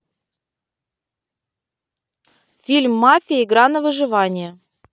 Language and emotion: Russian, positive